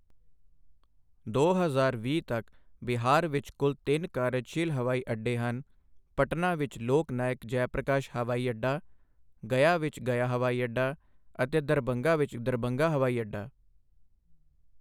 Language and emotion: Punjabi, neutral